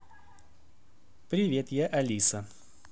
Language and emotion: Russian, positive